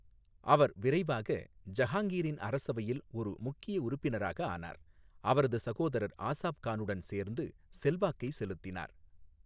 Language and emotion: Tamil, neutral